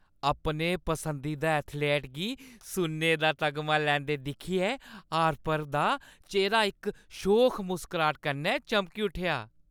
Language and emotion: Dogri, happy